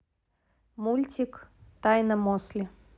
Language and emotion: Russian, neutral